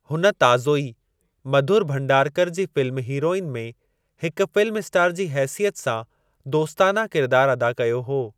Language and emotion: Sindhi, neutral